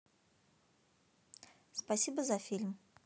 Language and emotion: Russian, positive